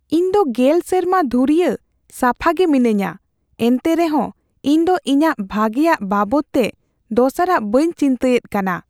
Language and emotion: Santali, fearful